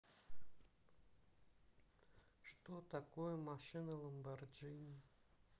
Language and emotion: Russian, sad